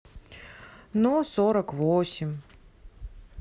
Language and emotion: Russian, sad